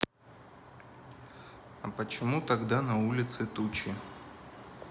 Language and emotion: Russian, neutral